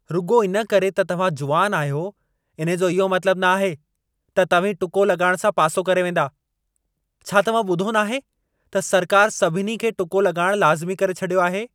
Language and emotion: Sindhi, angry